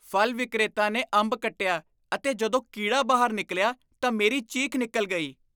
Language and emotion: Punjabi, disgusted